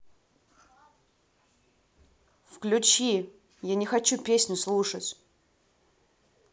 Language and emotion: Russian, angry